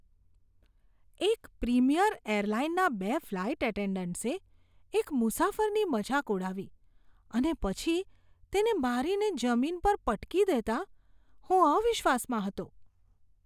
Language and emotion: Gujarati, disgusted